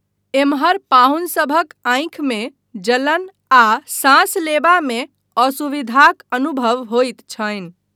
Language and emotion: Maithili, neutral